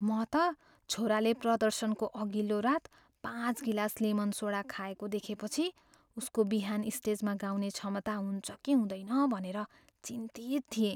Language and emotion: Nepali, fearful